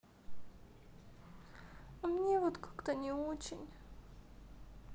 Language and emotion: Russian, sad